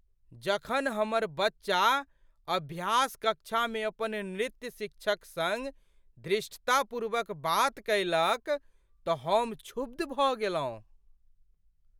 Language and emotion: Maithili, surprised